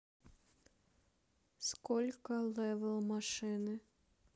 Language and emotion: Russian, neutral